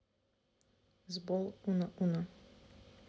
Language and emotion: Russian, neutral